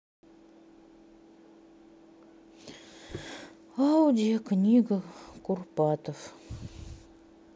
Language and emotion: Russian, sad